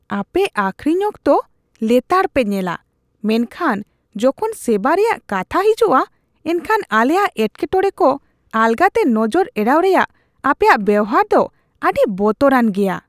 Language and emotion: Santali, disgusted